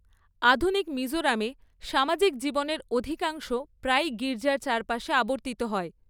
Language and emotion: Bengali, neutral